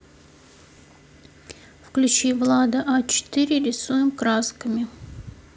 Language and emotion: Russian, neutral